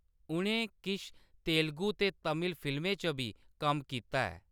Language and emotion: Dogri, neutral